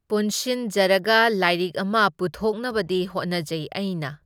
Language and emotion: Manipuri, neutral